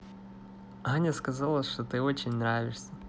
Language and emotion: Russian, positive